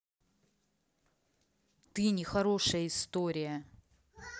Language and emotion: Russian, angry